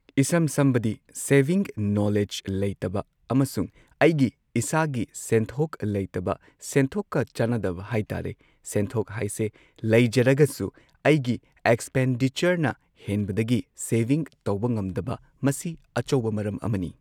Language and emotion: Manipuri, neutral